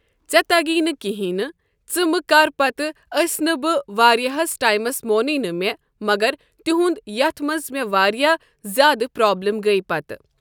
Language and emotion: Kashmiri, neutral